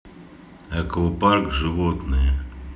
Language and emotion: Russian, neutral